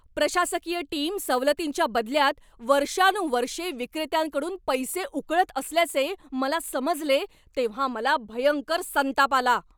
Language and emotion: Marathi, angry